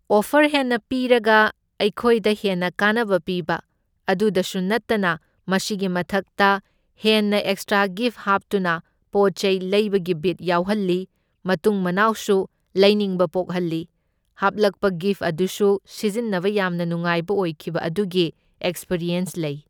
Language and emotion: Manipuri, neutral